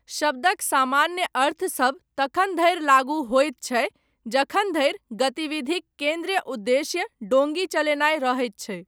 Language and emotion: Maithili, neutral